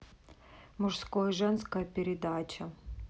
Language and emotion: Russian, neutral